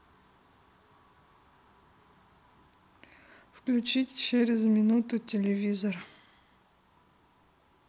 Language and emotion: Russian, neutral